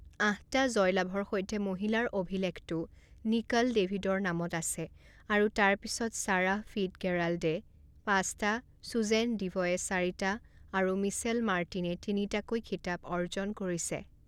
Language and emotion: Assamese, neutral